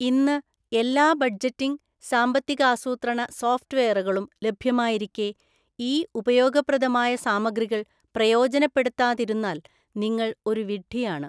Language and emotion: Malayalam, neutral